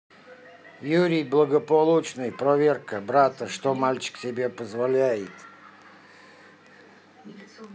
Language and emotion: Russian, neutral